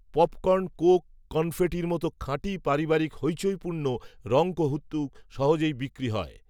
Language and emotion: Bengali, neutral